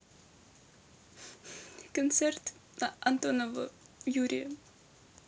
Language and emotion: Russian, sad